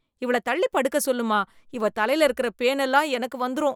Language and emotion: Tamil, disgusted